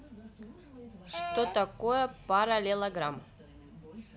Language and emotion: Russian, neutral